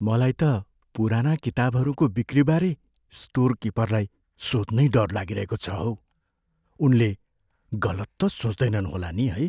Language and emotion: Nepali, fearful